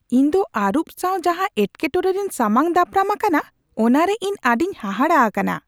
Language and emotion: Santali, surprised